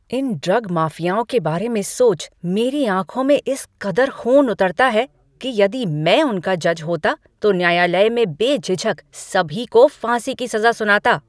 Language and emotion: Hindi, angry